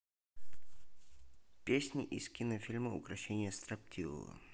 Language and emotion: Russian, neutral